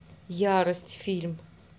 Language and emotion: Russian, neutral